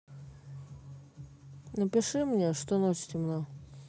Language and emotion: Russian, neutral